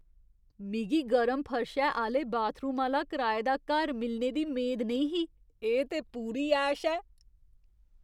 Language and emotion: Dogri, surprised